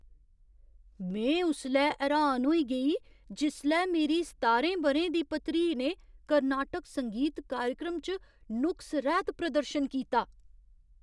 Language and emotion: Dogri, surprised